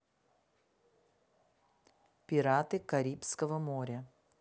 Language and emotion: Russian, neutral